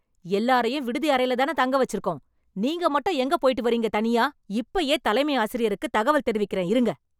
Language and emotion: Tamil, angry